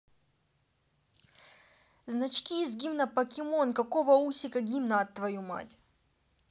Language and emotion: Russian, angry